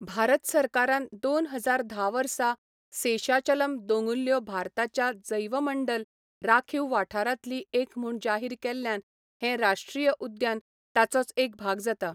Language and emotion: Goan Konkani, neutral